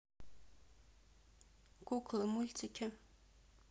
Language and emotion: Russian, neutral